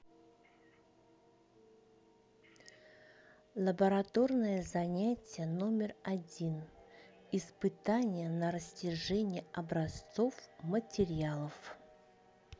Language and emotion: Russian, neutral